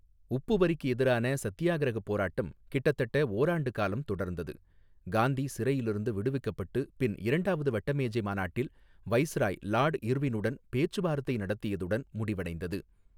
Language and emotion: Tamil, neutral